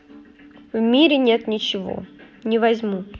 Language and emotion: Russian, neutral